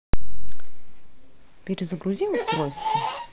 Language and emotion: Russian, neutral